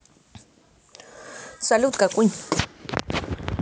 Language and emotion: Russian, neutral